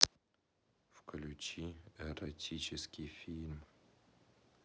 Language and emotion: Russian, neutral